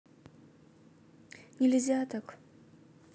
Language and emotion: Russian, sad